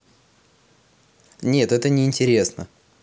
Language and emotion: Russian, neutral